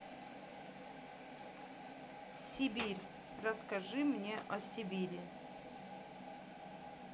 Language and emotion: Russian, neutral